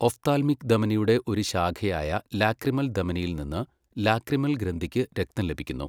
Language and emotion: Malayalam, neutral